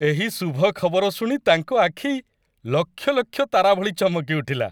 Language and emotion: Odia, happy